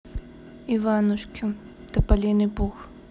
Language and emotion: Russian, neutral